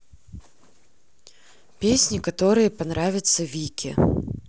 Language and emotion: Russian, neutral